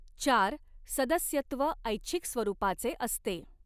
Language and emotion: Marathi, neutral